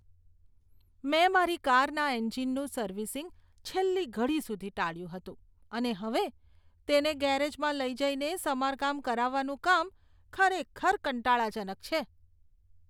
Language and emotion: Gujarati, disgusted